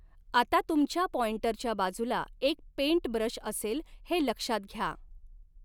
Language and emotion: Marathi, neutral